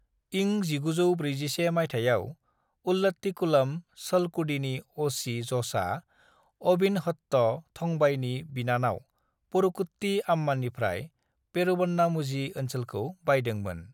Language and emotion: Bodo, neutral